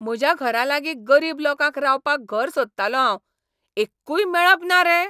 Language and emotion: Goan Konkani, angry